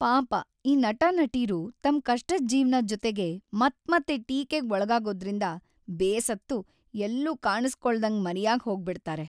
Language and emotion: Kannada, sad